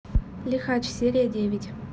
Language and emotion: Russian, neutral